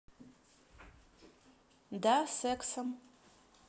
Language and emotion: Russian, neutral